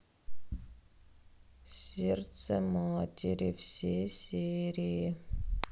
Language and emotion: Russian, sad